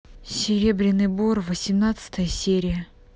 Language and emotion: Russian, neutral